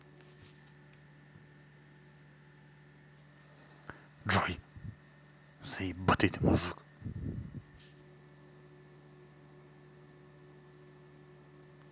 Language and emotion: Russian, angry